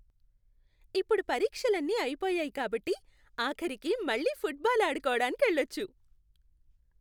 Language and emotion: Telugu, happy